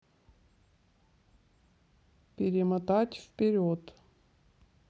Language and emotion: Russian, neutral